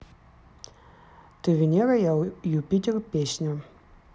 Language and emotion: Russian, neutral